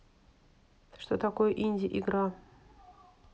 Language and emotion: Russian, neutral